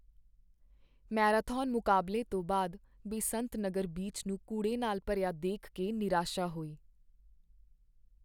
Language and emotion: Punjabi, sad